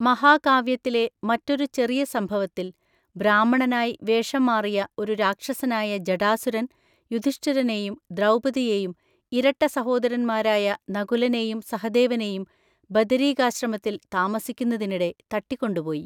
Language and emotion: Malayalam, neutral